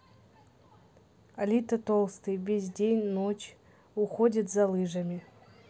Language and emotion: Russian, neutral